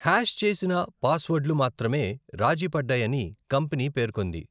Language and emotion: Telugu, neutral